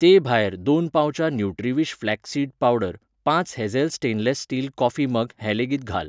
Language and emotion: Goan Konkani, neutral